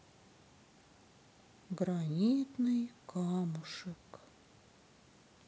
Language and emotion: Russian, sad